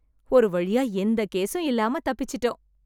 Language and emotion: Tamil, happy